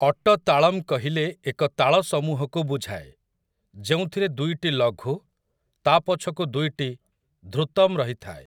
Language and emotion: Odia, neutral